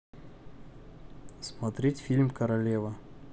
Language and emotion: Russian, neutral